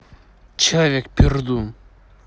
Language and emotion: Russian, neutral